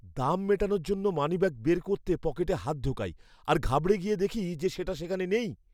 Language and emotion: Bengali, fearful